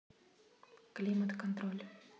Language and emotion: Russian, neutral